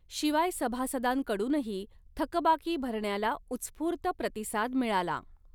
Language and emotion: Marathi, neutral